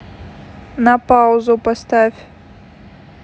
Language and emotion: Russian, neutral